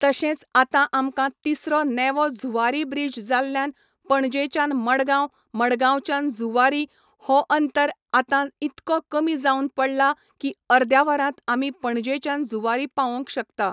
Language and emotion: Goan Konkani, neutral